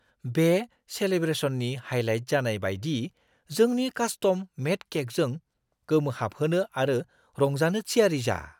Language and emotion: Bodo, surprised